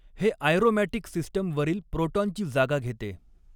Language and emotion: Marathi, neutral